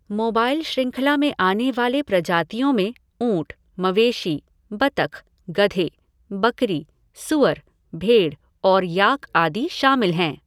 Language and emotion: Hindi, neutral